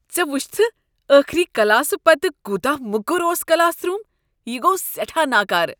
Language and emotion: Kashmiri, disgusted